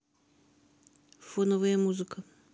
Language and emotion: Russian, neutral